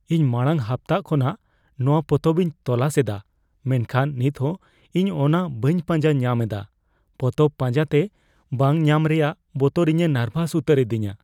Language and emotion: Santali, fearful